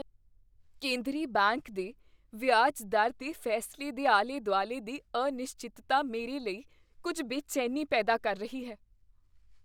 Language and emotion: Punjabi, fearful